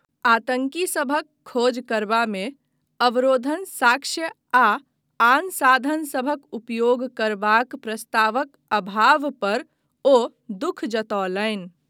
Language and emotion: Maithili, neutral